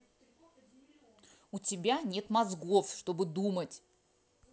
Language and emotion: Russian, angry